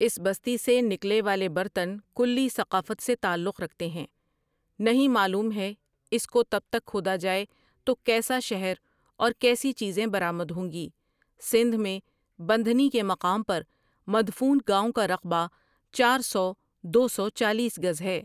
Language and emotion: Urdu, neutral